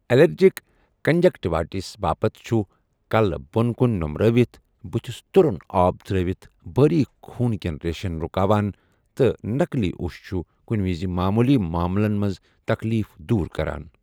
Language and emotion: Kashmiri, neutral